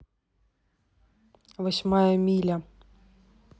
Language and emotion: Russian, neutral